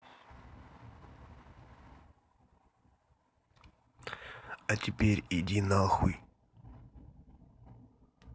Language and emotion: Russian, neutral